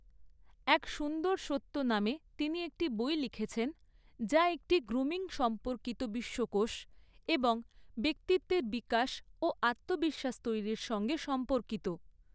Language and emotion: Bengali, neutral